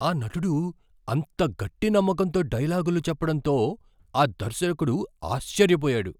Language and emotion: Telugu, surprised